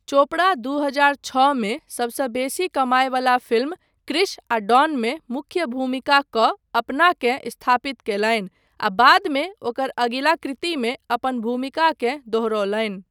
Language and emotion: Maithili, neutral